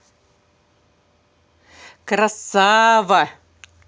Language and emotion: Russian, positive